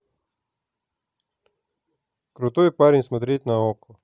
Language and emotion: Russian, neutral